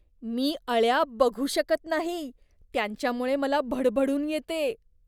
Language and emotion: Marathi, disgusted